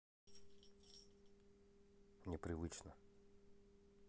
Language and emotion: Russian, neutral